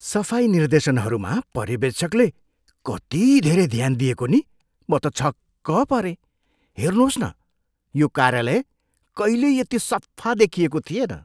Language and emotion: Nepali, surprised